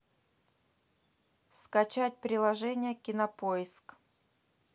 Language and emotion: Russian, neutral